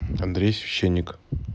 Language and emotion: Russian, neutral